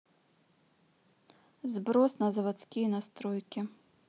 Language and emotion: Russian, neutral